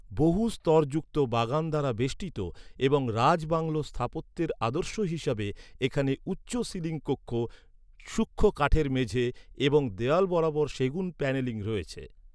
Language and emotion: Bengali, neutral